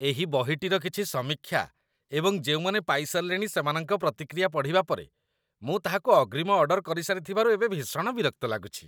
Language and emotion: Odia, disgusted